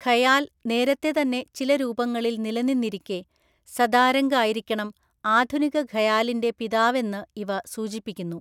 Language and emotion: Malayalam, neutral